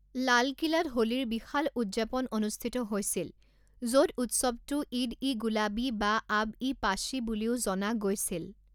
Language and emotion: Assamese, neutral